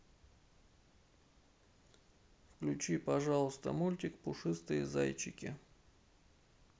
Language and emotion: Russian, sad